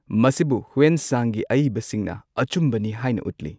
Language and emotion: Manipuri, neutral